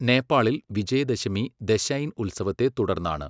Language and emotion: Malayalam, neutral